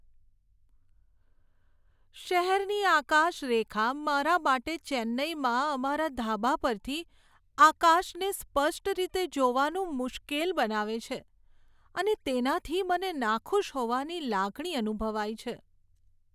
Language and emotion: Gujarati, sad